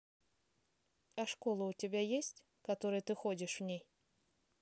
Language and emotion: Russian, neutral